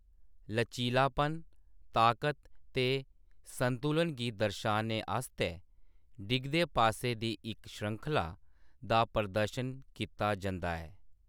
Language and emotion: Dogri, neutral